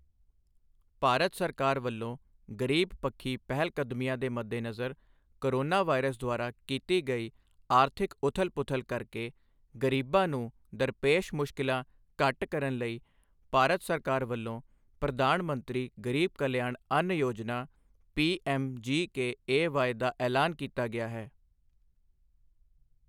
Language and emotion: Punjabi, neutral